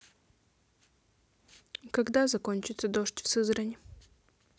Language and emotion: Russian, neutral